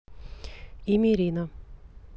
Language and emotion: Russian, neutral